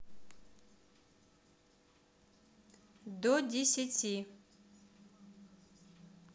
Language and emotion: Russian, neutral